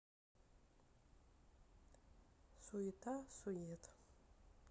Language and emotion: Russian, sad